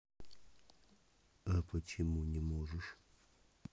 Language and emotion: Russian, neutral